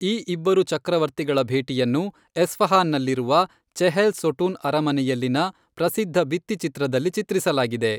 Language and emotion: Kannada, neutral